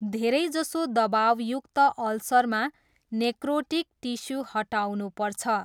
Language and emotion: Nepali, neutral